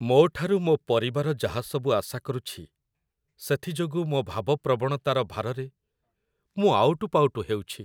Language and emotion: Odia, sad